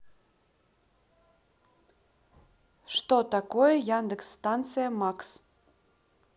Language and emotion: Russian, neutral